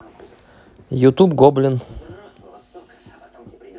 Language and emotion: Russian, neutral